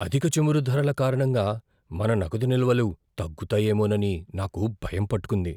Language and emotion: Telugu, fearful